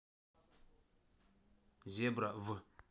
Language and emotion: Russian, neutral